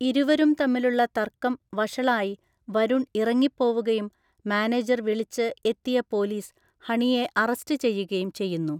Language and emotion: Malayalam, neutral